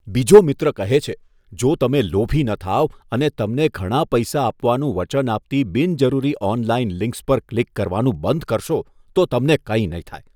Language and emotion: Gujarati, disgusted